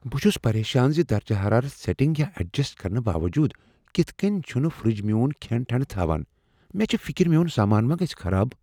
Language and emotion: Kashmiri, fearful